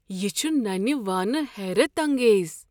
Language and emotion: Kashmiri, surprised